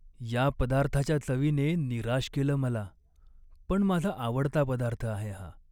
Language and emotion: Marathi, sad